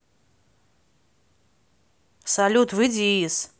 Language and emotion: Russian, neutral